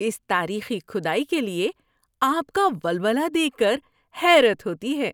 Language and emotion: Urdu, happy